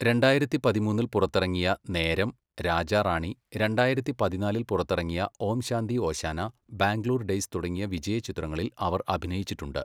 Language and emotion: Malayalam, neutral